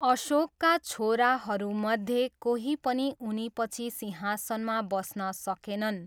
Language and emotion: Nepali, neutral